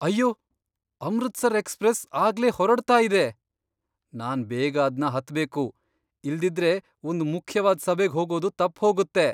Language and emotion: Kannada, surprised